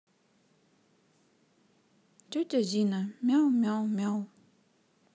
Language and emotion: Russian, sad